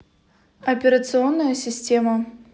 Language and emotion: Russian, neutral